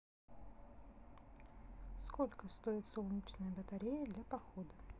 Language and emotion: Russian, neutral